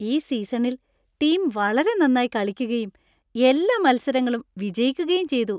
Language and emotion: Malayalam, happy